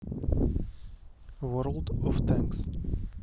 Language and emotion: Russian, neutral